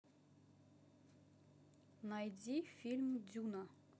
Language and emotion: Russian, neutral